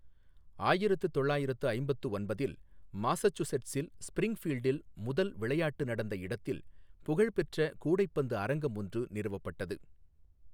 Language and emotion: Tamil, neutral